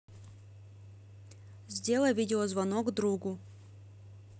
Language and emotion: Russian, neutral